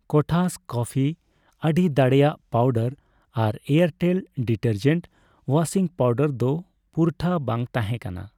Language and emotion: Santali, neutral